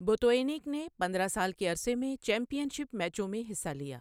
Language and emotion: Urdu, neutral